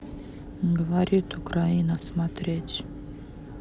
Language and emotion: Russian, sad